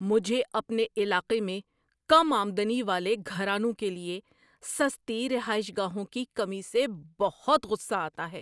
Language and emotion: Urdu, angry